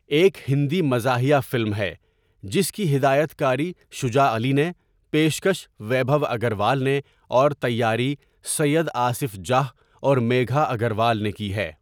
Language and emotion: Urdu, neutral